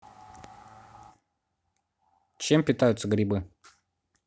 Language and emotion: Russian, neutral